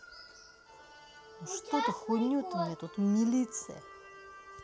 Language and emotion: Russian, angry